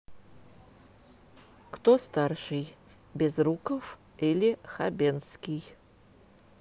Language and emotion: Russian, neutral